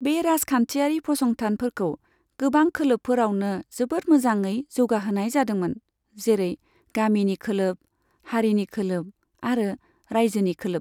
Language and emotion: Bodo, neutral